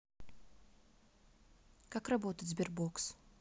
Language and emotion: Russian, neutral